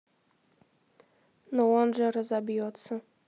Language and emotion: Russian, neutral